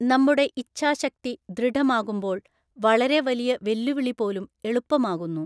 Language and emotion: Malayalam, neutral